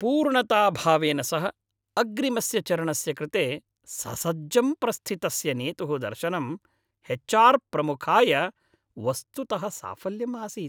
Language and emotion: Sanskrit, happy